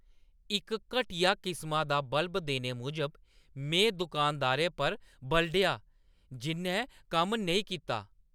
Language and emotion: Dogri, angry